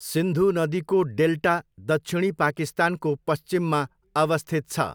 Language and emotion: Nepali, neutral